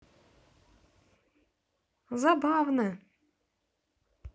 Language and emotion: Russian, positive